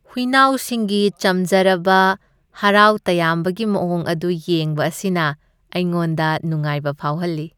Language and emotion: Manipuri, happy